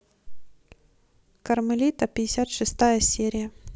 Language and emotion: Russian, neutral